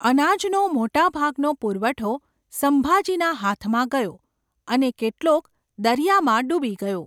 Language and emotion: Gujarati, neutral